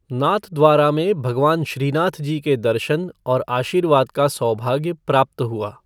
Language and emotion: Hindi, neutral